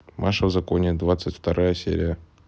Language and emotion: Russian, neutral